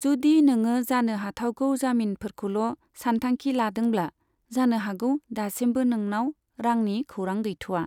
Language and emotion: Bodo, neutral